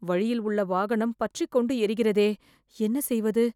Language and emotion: Tamil, fearful